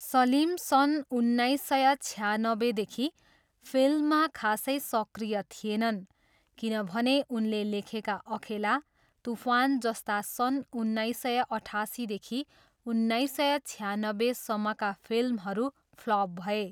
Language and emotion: Nepali, neutral